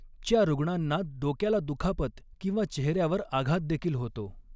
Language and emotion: Marathi, neutral